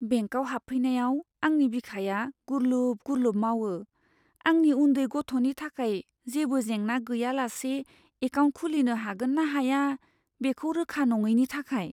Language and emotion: Bodo, fearful